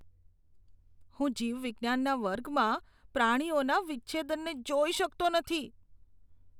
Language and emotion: Gujarati, disgusted